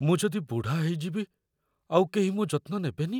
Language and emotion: Odia, fearful